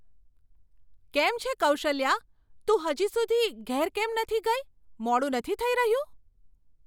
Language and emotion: Gujarati, surprised